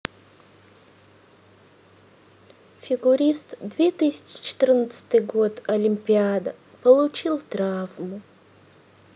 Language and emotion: Russian, sad